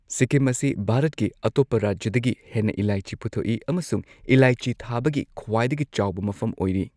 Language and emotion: Manipuri, neutral